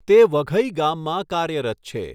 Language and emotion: Gujarati, neutral